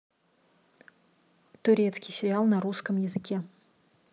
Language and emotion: Russian, neutral